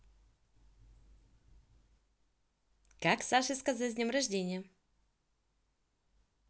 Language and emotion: Russian, positive